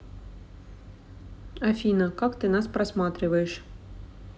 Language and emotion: Russian, neutral